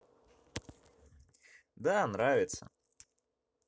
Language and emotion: Russian, positive